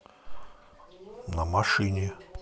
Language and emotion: Russian, neutral